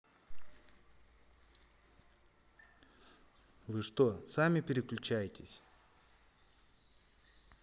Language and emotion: Russian, neutral